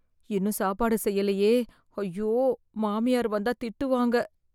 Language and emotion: Tamil, fearful